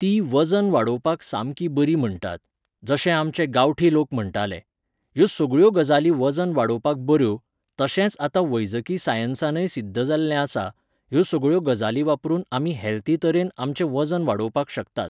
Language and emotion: Goan Konkani, neutral